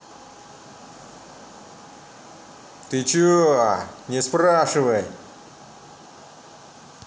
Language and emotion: Russian, angry